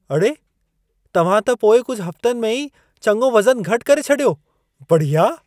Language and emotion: Sindhi, surprised